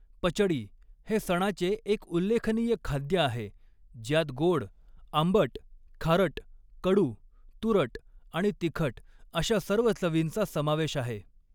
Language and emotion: Marathi, neutral